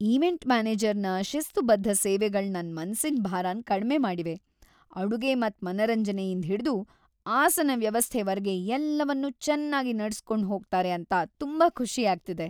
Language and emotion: Kannada, happy